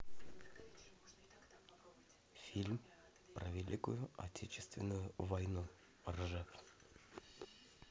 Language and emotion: Russian, neutral